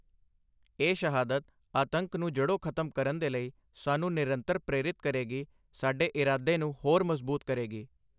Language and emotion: Punjabi, neutral